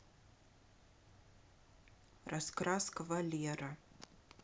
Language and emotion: Russian, neutral